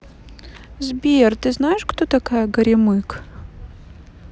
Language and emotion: Russian, sad